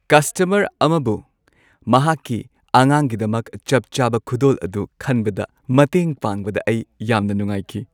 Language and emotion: Manipuri, happy